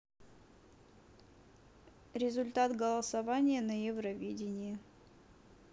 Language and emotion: Russian, neutral